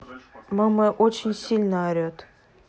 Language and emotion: Russian, neutral